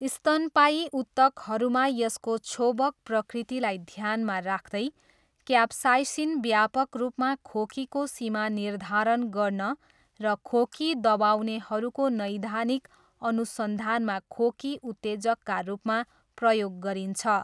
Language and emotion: Nepali, neutral